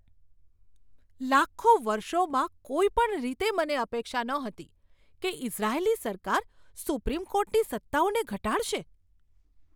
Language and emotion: Gujarati, surprised